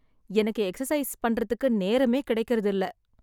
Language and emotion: Tamil, sad